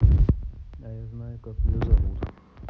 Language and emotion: Russian, neutral